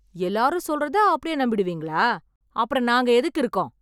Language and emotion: Tamil, angry